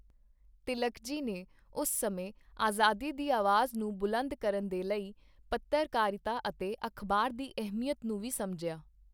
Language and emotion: Punjabi, neutral